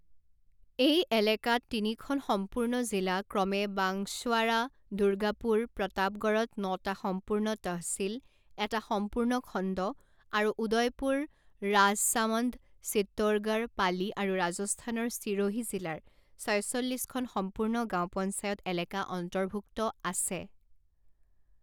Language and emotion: Assamese, neutral